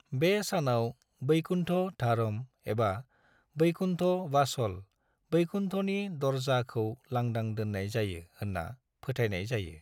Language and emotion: Bodo, neutral